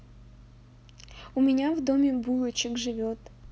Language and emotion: Russian, neutral